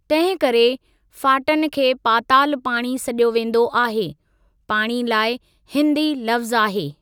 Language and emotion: Sindhi, neutral